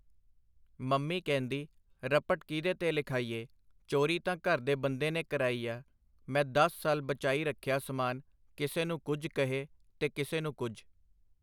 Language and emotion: Punjabi, neutral